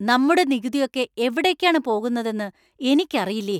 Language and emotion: Malayalam, angry